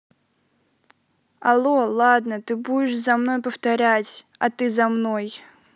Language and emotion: Russian, sad